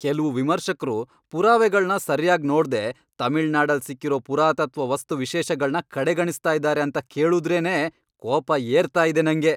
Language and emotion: Kannada, angry